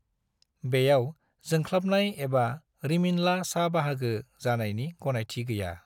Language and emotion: Bodo, neutral